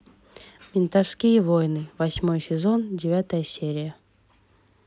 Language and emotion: Russian, neutral